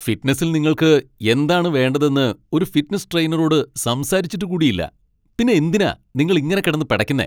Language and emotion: Malayalam, angry